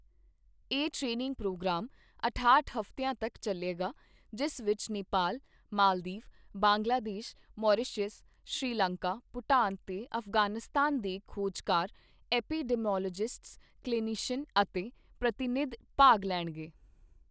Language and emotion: Punjabi, neutral